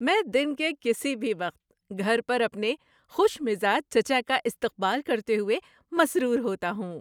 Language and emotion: Urdu, happy